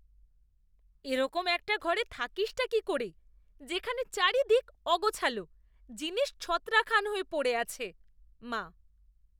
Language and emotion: Bengali, disgusted